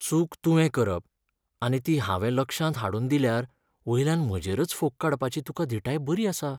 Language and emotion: Goan Konkani, sad